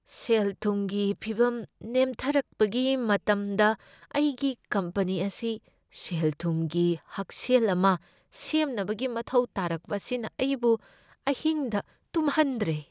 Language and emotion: Manipuri, fearful